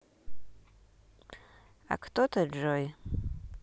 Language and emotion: Russian, neutral